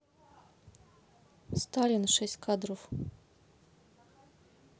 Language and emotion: Russian, neutral